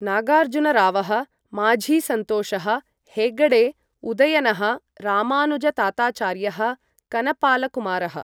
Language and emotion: Sanskrit, neutral